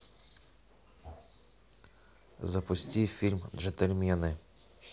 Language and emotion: Russian, neutral